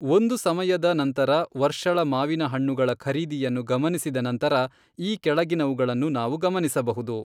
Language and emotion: Kannada, neutral